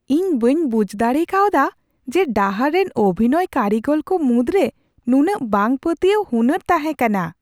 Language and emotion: Santali, surprised